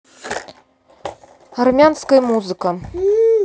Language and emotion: Russian, neutral